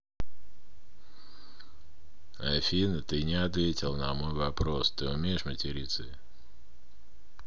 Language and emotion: Russian, neutral